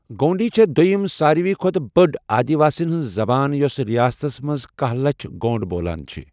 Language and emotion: Kashmiri, neutral